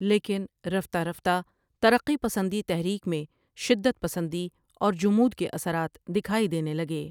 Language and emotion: Urdu, neutral